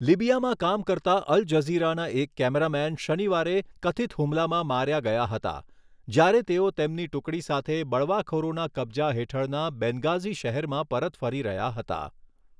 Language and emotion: Gujarati, neutral